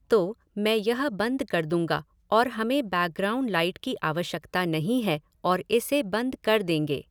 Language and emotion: Hindi, neutral